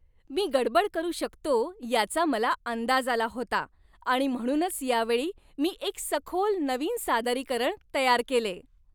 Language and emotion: Marathi, happy